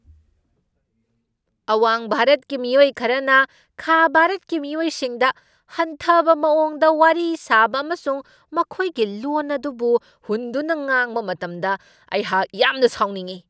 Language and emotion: Manipuri, angry